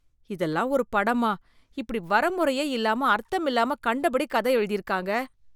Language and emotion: Tamil, disgusted